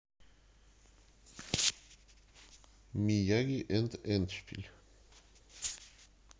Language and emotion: Russian, neutral